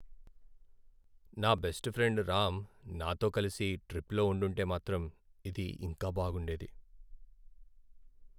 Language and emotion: Telugu, sad